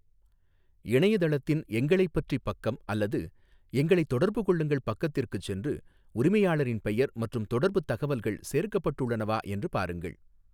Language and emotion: Tamil, neutral